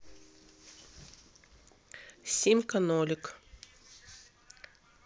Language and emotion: Russian, neutral